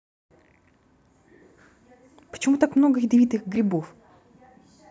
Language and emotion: Russian, neutral